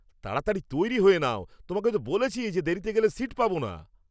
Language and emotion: Bengali, angry